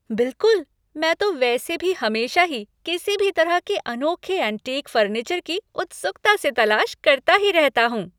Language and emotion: Hindi, happy